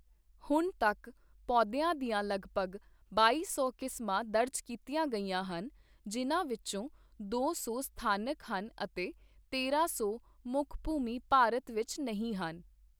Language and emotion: Punjabi, neutral